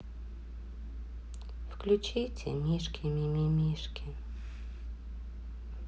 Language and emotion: Russian, sad